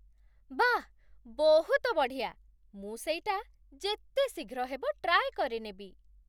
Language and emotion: Odia, surprised